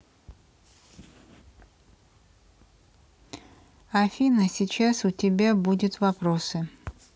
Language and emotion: Russian, neutral